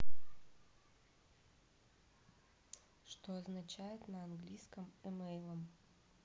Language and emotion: Russian, neutral